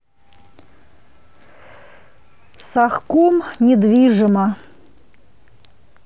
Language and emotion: Russian, neutral